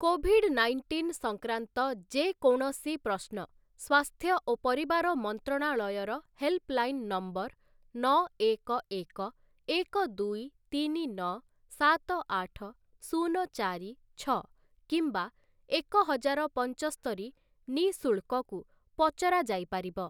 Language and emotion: Odia, neutral